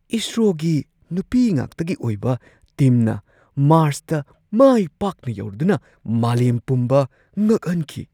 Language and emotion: Manipuri, surprised